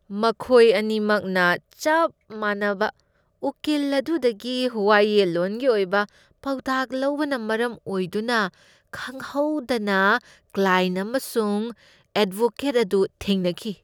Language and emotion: Manipuri, disgusted